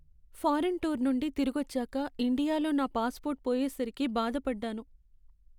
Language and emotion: Telugu, sad